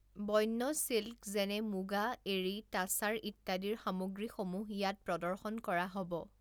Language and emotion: Assamese, neutral